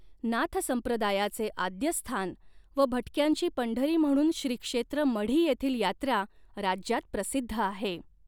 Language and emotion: Marathi, neutral